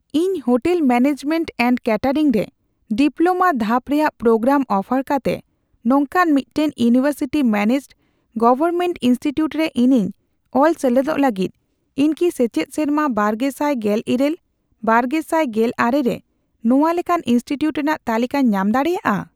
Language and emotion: Santali, neutral